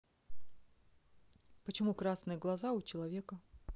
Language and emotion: Russian, neutral